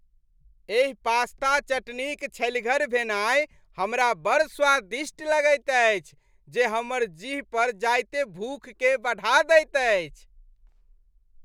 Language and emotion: Maithili, happy